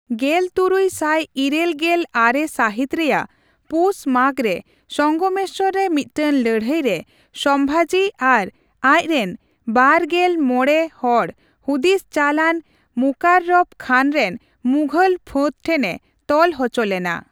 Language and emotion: Santali, neutral